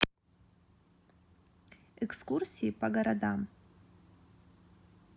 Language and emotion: Russian, neutral